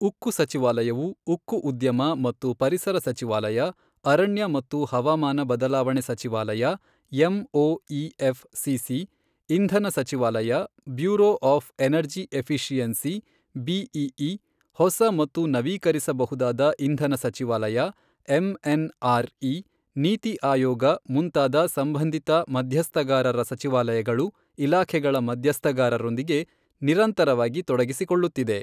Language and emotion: Kannada, neutral